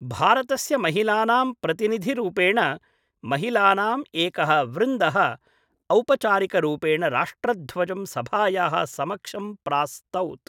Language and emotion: Sanskrit, neutral